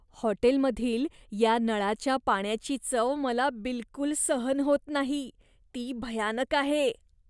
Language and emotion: Marathi, disgusted